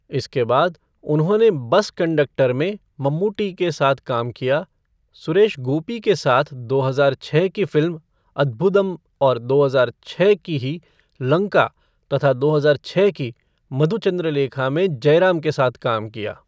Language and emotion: Hindi, neutral